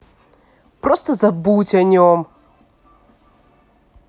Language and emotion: Russian, angry